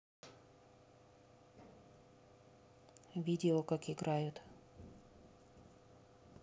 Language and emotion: Russian, neutral